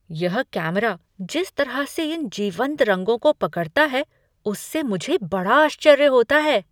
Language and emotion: Hindi, surprised